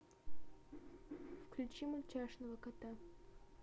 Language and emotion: Russian, neutral